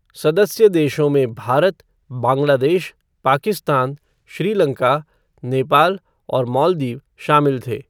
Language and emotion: Hindi, neutral